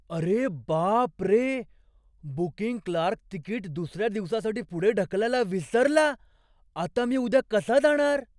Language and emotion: Marathi, surprised